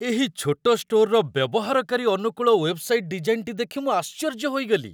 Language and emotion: Odia, surprised